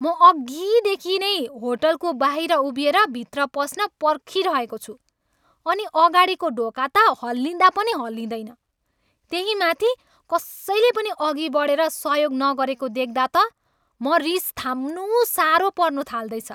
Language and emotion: Nepali, angry